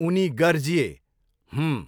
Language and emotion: Nepali, neutral